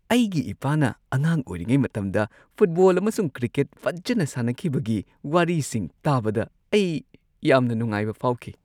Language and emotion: Manipuri, happy